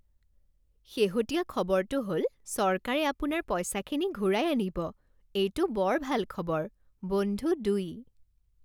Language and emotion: Assamese, happy